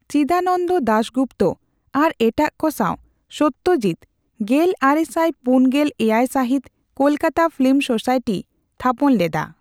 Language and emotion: Santali, neutral